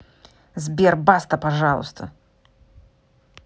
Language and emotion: Russian, angry